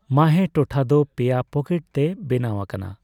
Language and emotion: Santali, neutral